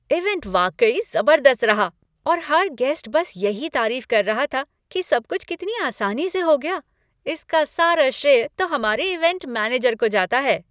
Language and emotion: Hindi, happy